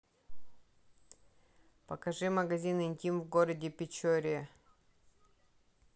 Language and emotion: Russian, neutral